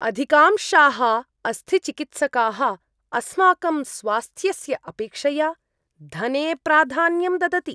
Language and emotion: Sanskrit, disgusted